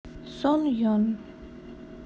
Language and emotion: Russian, sad